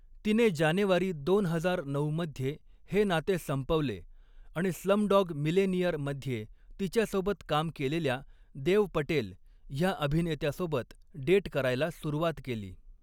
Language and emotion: Marathi, neutral